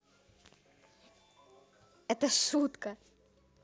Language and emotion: Russian, positive